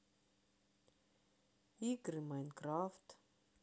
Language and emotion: Russian, sad